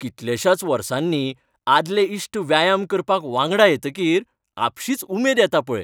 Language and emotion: Goan Konkani, happy